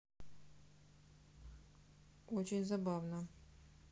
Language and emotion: Russian, neutral